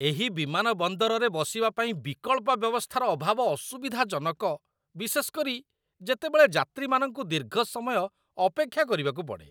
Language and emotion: Odia, disgusted